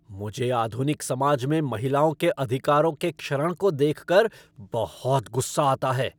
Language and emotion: Hindi, angry